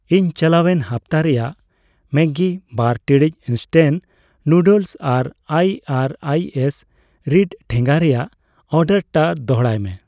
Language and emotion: Santali, neutral